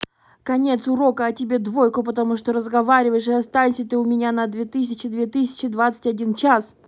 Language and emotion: Russian, angry